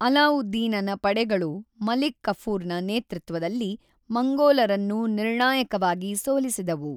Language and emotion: Kannada, neutral